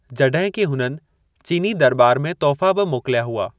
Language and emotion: Sindhi, neutral